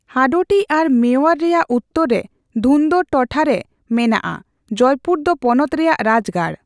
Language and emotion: Santali, neutral